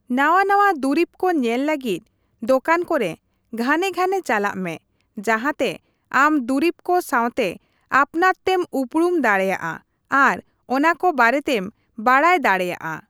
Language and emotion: Santali, neutral